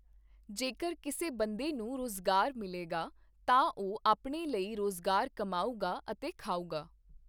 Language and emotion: Punjabi, neutral